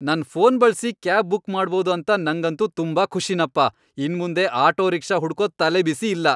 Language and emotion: Kannada, happy